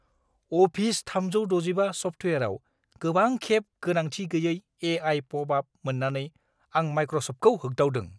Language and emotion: Bodo, angry